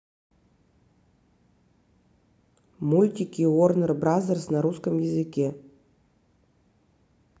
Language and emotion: Russian, neutral